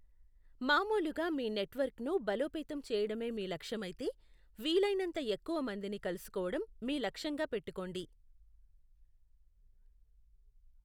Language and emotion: Telugu, neutral